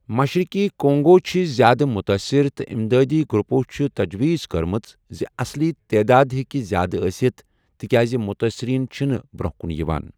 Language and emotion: Kashmiri, neutral